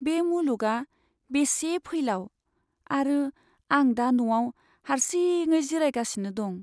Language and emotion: Bodo, sad